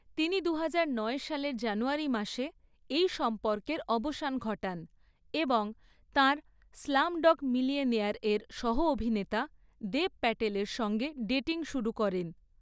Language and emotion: Bengali, neutral